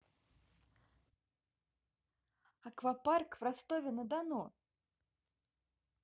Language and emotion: Russian, positive